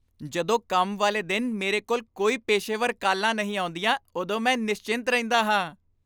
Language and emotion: Punjabi, happy